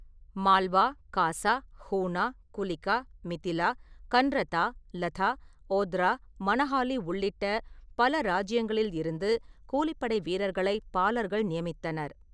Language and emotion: Tamil, neutral